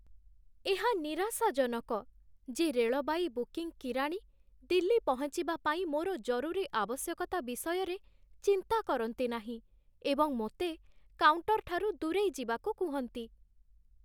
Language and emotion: Odia, sad